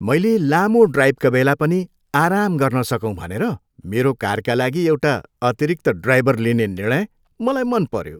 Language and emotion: Nepali, happy